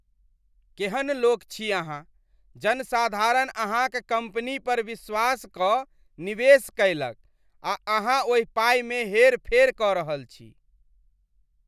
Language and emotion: Maithili, disgusted